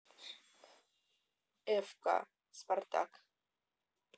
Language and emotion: Russian, neutral